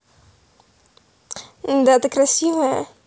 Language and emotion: Russian, positive